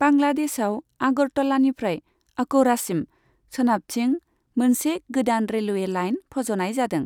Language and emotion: Bodo, neutral